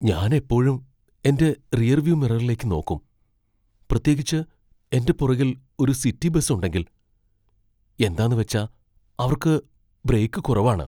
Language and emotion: Malayalam, fearful